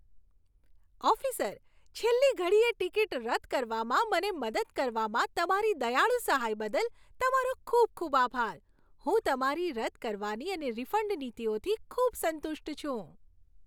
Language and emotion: Gujarati, happy